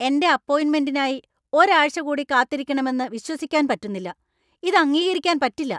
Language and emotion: Malayalam, angry